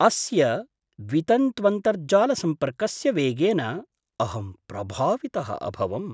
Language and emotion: Sanskrit, surprised